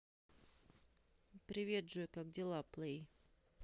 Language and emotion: Russian, neutral